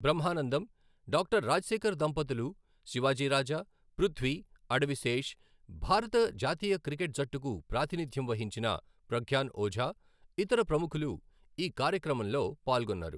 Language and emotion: Telugu, neutral